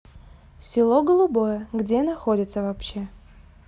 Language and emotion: Russian, neutral